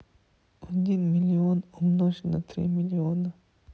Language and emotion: Russian, sad